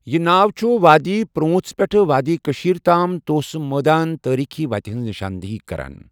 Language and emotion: Kashmiri, neutral